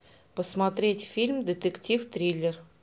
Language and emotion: Russian, positive